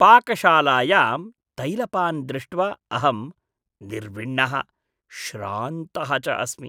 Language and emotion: Sanskrit, disgusted